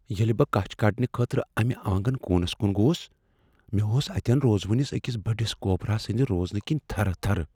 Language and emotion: Kashmiri, fearful